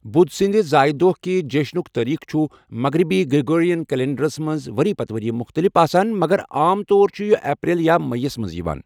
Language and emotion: Kashmiri, neutral